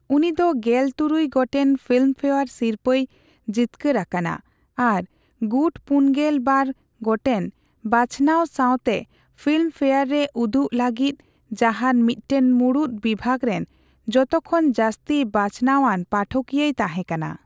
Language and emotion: Santali, neutral